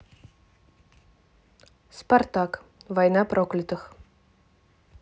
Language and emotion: Russian, neutral